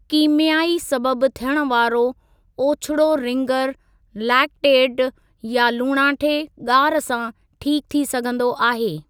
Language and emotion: Sindhi, neutral